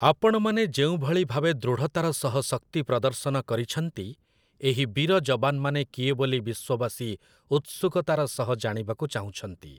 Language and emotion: Odia, neutral